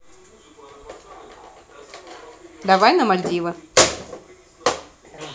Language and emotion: Russian, neutral